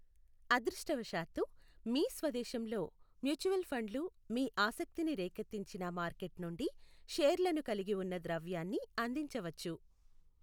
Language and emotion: Telugu, neutral